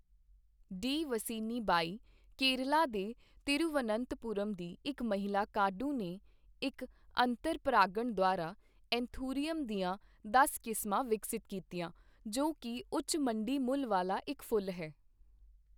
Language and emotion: Punjabi, neutral